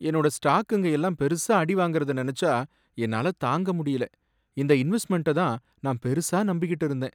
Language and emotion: Tamil, sad